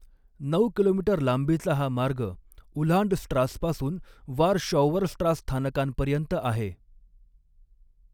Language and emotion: Marathi, neutral